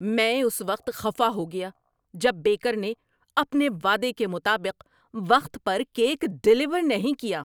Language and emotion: Urdu, angry